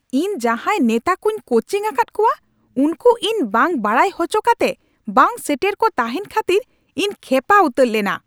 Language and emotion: Santali, angry